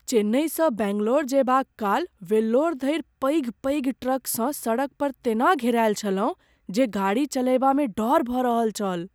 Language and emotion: Maithili, fearful